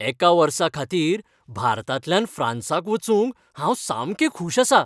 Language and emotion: Goan Konkani, happy